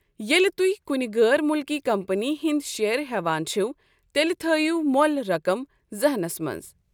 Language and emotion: Kashmiri, neutral